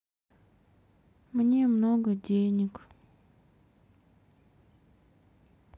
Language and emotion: Russian, sad